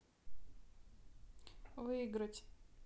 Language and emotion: Russian, neutral